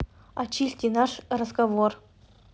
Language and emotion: Russian, neutral